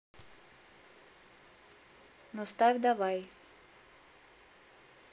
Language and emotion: Russian, neutral